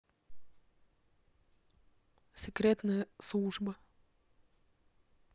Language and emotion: Russian, neutral